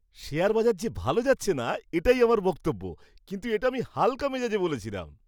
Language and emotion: Bengali, happy